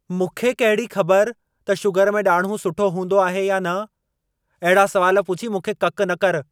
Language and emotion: Sindhi, angry